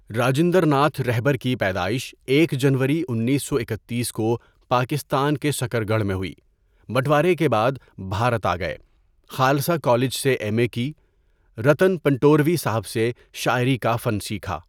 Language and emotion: Urdu, neutral